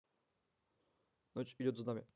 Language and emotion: Russian, neutral